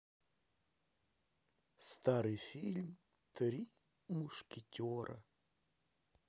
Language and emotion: Russian, sad